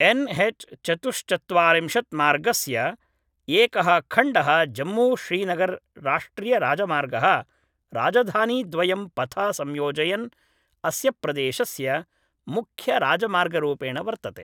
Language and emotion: Sanskrit, neutral